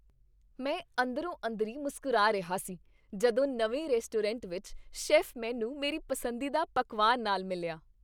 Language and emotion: Punjabi, happy